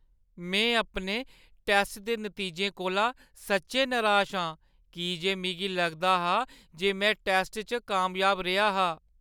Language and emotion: Dogri, sad